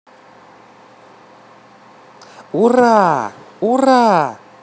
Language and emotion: Russian, positive